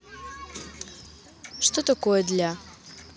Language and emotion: Russian, neutral